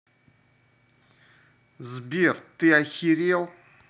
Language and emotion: Russian, angry